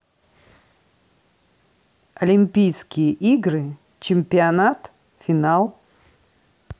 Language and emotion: Russian, neutral